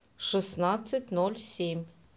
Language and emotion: Russian, neutral